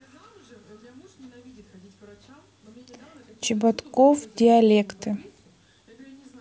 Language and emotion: Russian, neutral